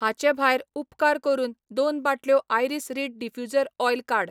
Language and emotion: Goan Konkani, neutral